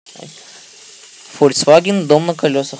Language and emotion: Russian, neutral